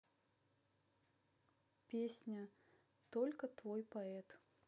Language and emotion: Russian, neutral